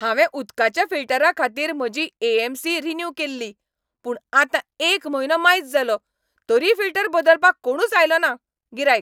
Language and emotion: Goan Konkani, angry